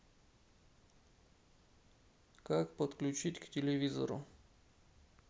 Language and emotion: Russian, neutral